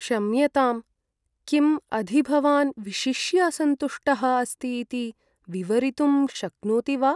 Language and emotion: Sanskrit, sad